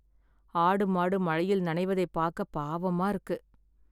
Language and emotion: Tamil, sad